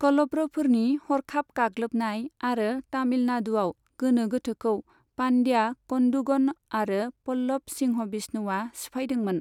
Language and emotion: Bodo, neutral